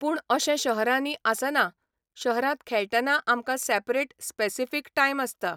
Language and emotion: Goan Konkani, neutral